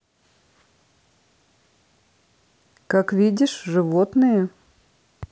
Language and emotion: Russian, neutral